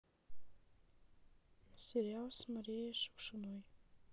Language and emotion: Russian, sad